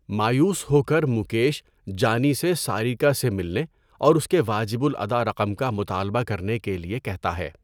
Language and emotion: Urdu, neutral